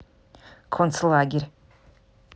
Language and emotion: Russian, neutral